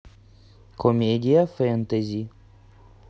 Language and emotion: Russian, neutral